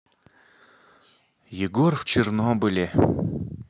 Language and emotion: Russian, sad